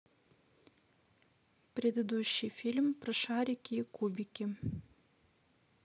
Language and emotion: Russian, neutral